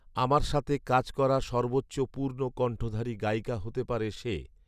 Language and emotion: Bengali, neutral